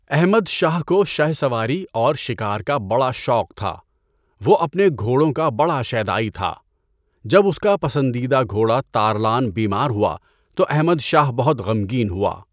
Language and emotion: Urdu, neutral